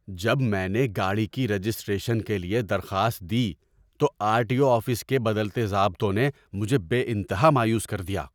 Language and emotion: Urdu, angry